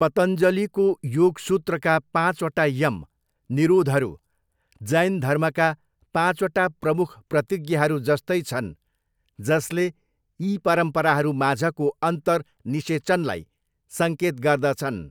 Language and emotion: Nepali, neutral